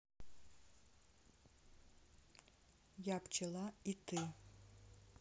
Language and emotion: Russian, neutral